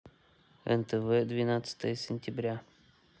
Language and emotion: Russian, neutral